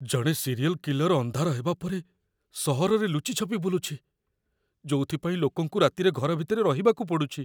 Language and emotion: Odia, fearful